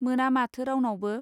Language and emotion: Bodo, neutral